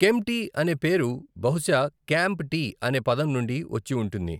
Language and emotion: Telugu, neutral